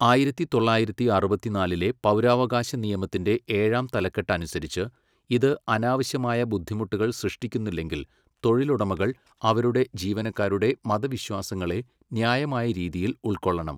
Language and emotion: Malayalam, neutral